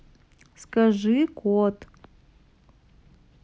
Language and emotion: Russian, neutral